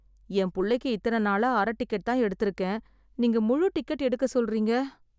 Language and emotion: Tamil, sad